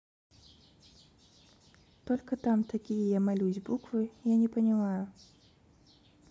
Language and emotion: Russian, neutral